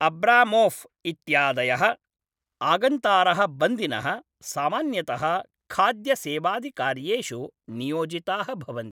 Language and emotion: Sanskrit, neutral